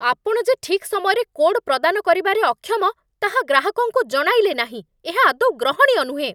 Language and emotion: Odia, angry